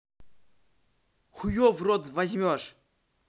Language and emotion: Russian, angry